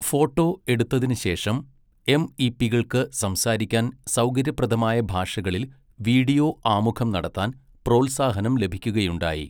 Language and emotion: Malayalam, neutral